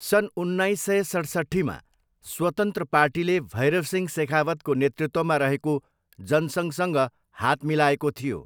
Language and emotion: Nepali, neutral